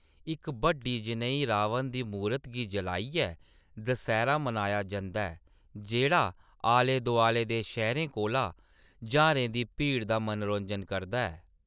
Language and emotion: Dogri, neutral